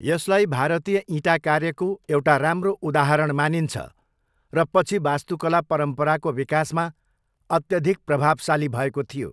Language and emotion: Nepali, neutral